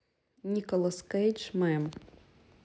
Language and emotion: Russian, neutral